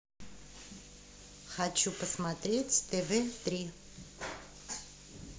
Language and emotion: Russian, neutral